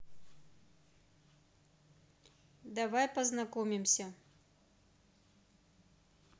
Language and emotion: Russian, neutral